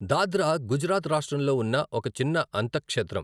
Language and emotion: Telugu, neutral